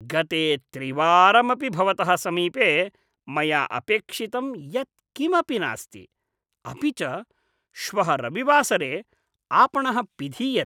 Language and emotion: Sanskrit, disgusted